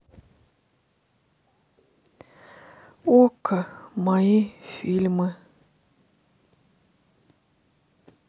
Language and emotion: Russian, sad